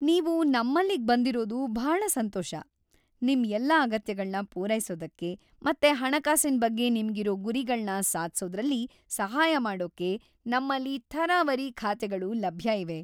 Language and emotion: Kannada, happy